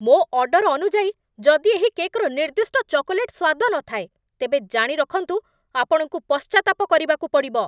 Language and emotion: Odia, angry